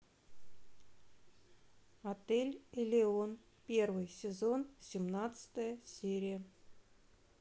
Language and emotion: Russian, neutral